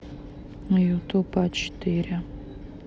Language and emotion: Russian, neutral